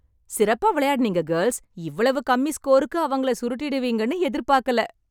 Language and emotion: Tamil, happy